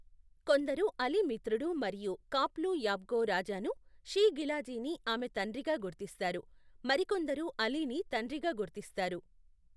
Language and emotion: Telugu, neutral